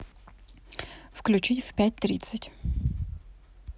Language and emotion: Russian, neutral